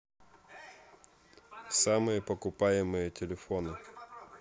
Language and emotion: Russian, neutral